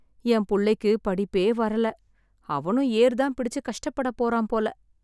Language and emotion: Tamil, sad